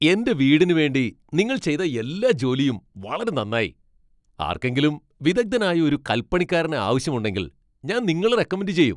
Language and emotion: Malayalam, happy